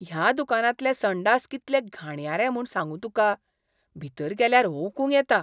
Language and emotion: Goan Konkani, disgusted